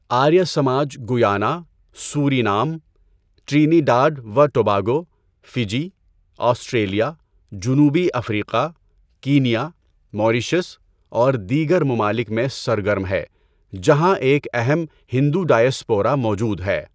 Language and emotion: Urdu, neutral